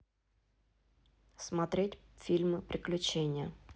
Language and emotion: Russian, neutral